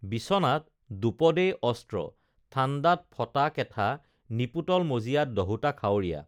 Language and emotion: Assamese, neutral